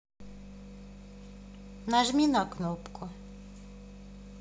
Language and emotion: Russian, neutral